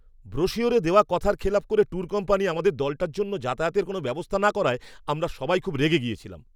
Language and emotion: Bengali, angry